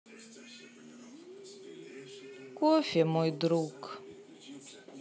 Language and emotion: Russian, sad